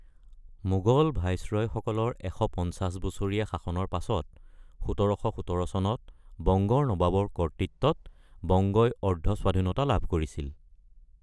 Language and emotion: Assamese, neutral